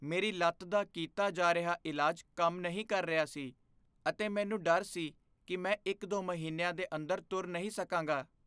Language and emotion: Punjabi, fearful